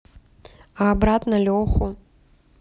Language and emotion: Russian, neutral